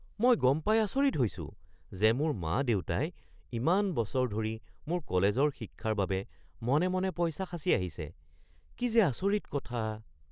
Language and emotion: Assamese, surprised